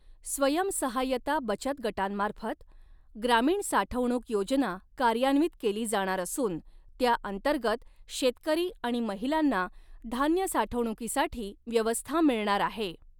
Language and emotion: Marathi, neutral